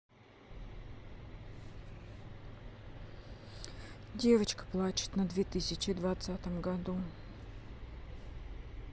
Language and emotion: Russian, sad